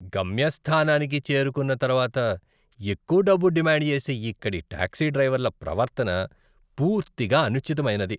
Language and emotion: Telugu, disgusted